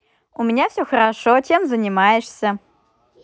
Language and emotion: Russian, positive